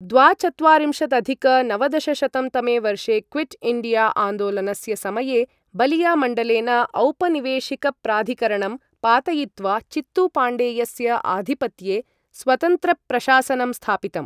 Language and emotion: Sanskrit, neutral